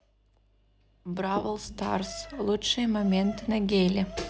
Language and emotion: Russian, neutral